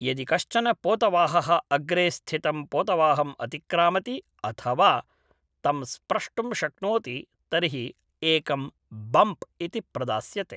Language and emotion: Sanskrit, neutral